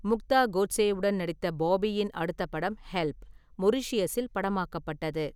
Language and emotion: Tamil, neutral